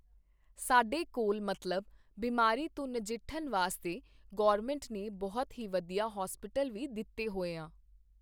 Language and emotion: Punjabi, neutral